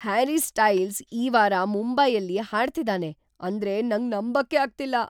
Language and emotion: Kannada, surprised